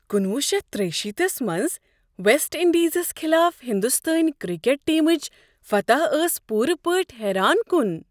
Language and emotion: Kashmiri, surprised